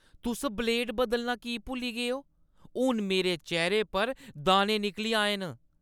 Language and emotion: Dogri, angry